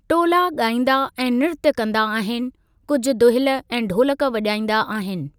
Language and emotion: Sindhi, neutral